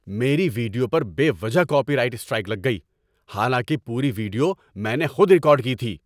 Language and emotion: Urdu, angry